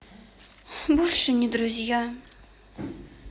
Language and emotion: Russian, sad